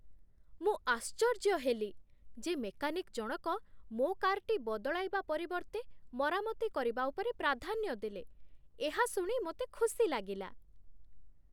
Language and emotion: Odia, surprised